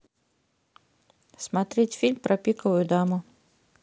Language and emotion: Russian, neutral